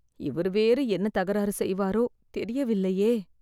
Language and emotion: Tamil, fearful